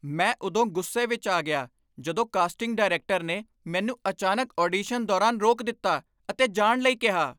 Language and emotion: Punjabi, angry